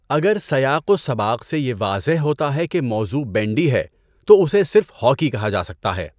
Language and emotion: Urdu, neutral